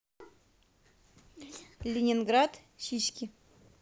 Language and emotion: Russian, neutral